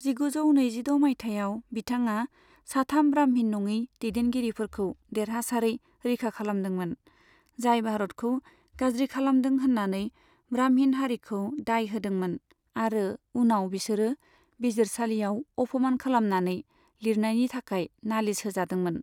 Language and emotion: Bodo, neutral